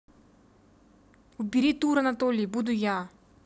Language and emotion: Russian, angry